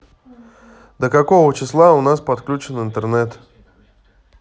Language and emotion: Russian, neutral